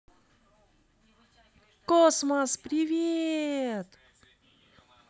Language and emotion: Russian, positive